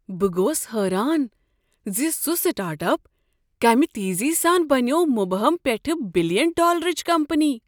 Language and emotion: Kashmiri, surprised